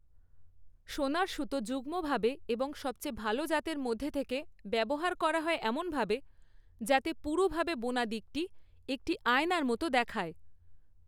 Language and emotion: Bengali, neutral